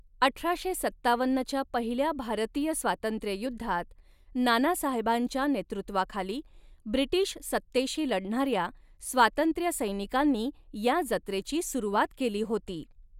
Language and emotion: Marathi, neutral